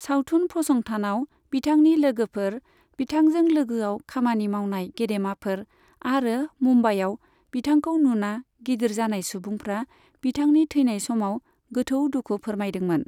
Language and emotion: Bodo, neutral